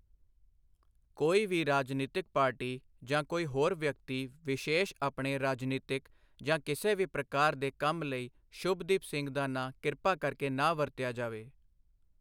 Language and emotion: Punjabi, neutral